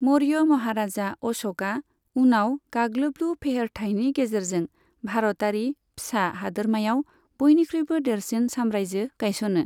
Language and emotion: Bodo, neutral